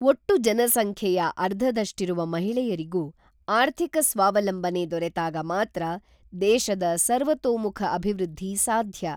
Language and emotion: Kannada, neutral